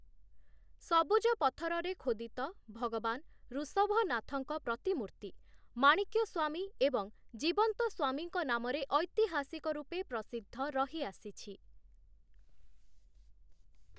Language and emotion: Odia, neutral